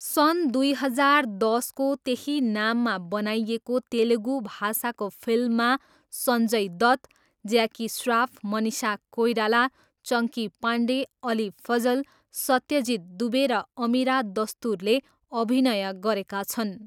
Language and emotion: Nepali, neutral